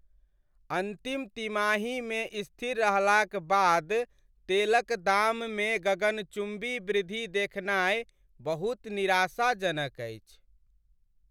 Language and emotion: Maithili, sad